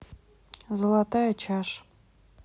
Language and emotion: Russian, neutral